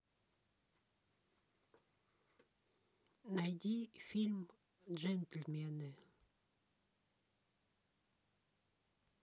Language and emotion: Russian, neutral